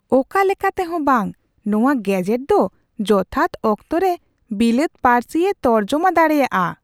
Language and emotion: Santali, surprised